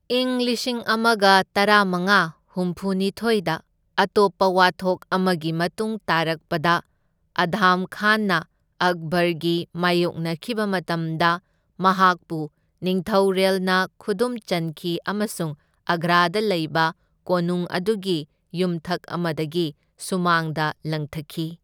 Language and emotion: Manipuri, neutral